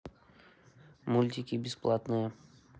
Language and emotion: Russian, neutral